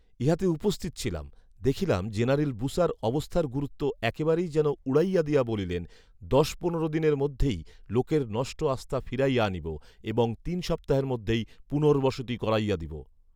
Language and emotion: Bengali, neutral